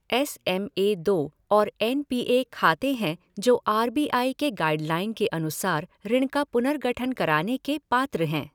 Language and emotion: Hindi, neutral